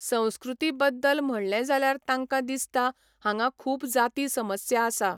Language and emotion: Goan Konkani, neutral